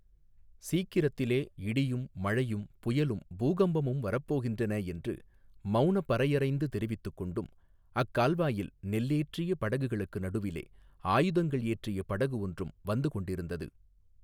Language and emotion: Tamil, neutral